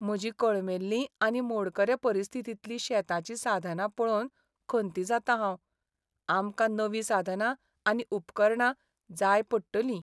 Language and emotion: Goan Konkani, sad